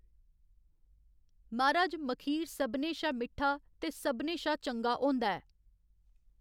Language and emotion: Dogri, neutral